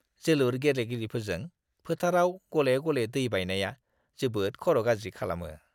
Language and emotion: Bodo, disgusted